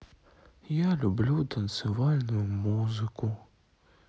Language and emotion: Russian, sad